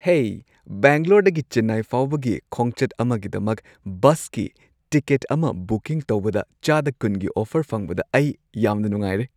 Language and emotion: Manipuri, happy